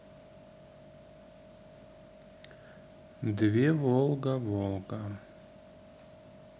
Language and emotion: Russian, neutral